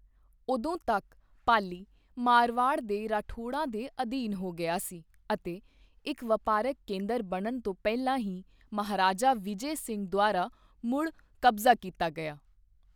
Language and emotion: Punjabi, neutral